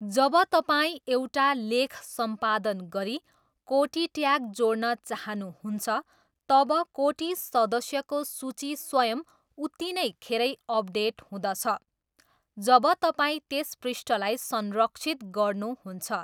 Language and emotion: Nepali, neutral